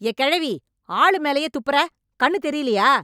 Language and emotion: Tamil, angry